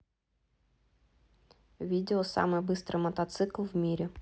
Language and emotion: Russian, neutral